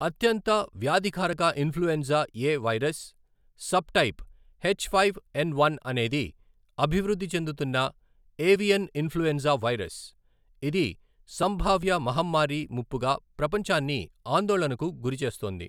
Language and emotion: Telugu, neutral